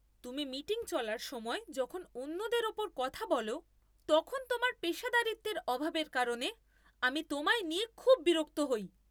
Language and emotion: Bengali, angry